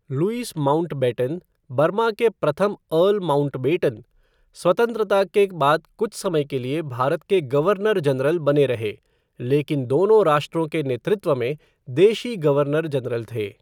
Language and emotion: Hindi, neutral